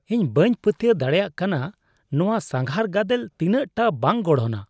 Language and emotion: Santali, disgusted